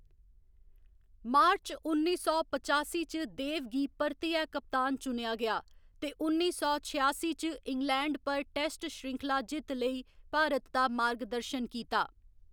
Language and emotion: Dogri, neutral